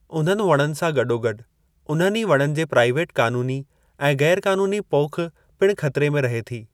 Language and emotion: Sindhi, neutral